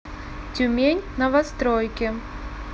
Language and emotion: Russian, neutral